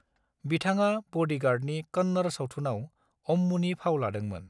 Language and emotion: Bodo, neutral